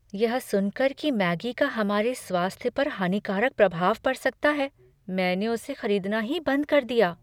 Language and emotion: Hindi, fearful